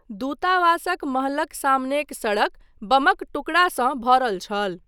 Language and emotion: Maithili, neutral